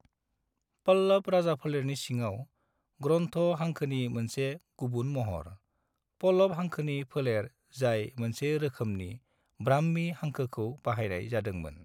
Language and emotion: Bodo, neutral